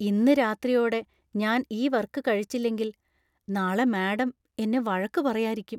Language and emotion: Malayalam, fearful